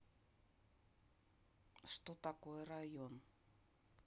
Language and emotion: Russian, neutral